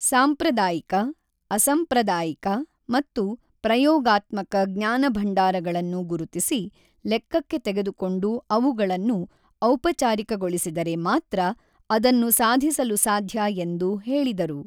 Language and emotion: Kannada, neutral